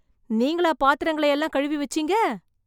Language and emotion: Tamil, surprised